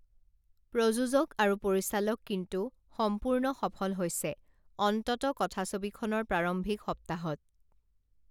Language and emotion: Assamese, neutral